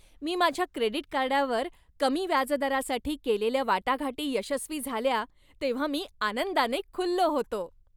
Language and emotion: Marathi, happy